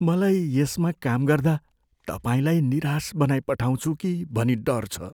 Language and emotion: Nepali, fearful